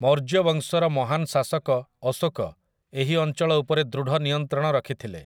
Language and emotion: Odia, neutral